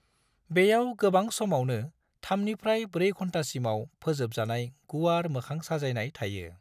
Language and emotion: Bodo, neutral